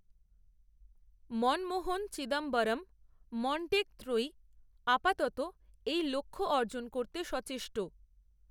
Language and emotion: Bengali, neutral